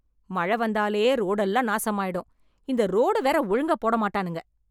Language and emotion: Tamil, angry